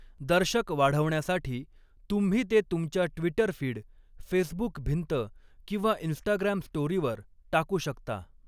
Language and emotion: Marathi, neutral